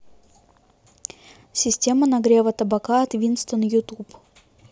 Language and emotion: Russian, neutral